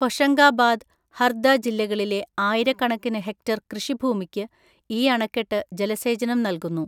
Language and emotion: Malayalam, neutral